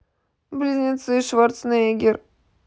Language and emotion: Russian, sad